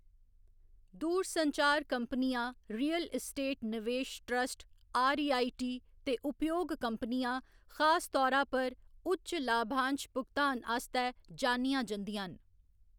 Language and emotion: Dogri, neutral